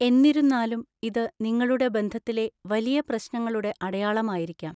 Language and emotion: Malayalam, neutral